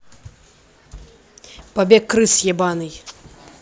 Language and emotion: Russian, angry